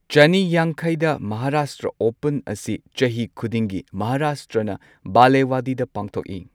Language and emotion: Manipuri, neutral